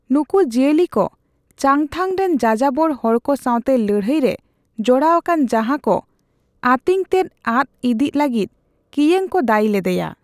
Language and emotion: Santali, neutral